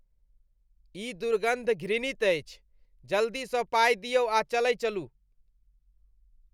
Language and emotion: Maithili, disgusted